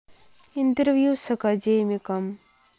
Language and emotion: Russian, sad